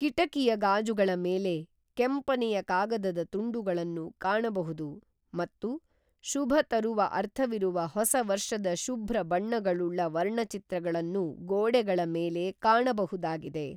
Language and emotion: Kannada, neutral